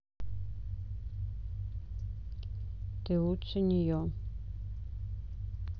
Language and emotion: Russian, neutral